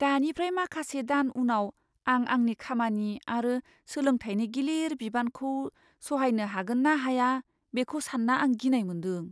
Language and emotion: Bodo, fearful